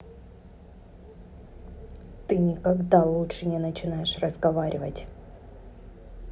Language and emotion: Russian, angry